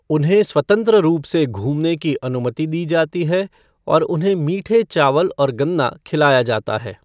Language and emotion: Hindi, neutral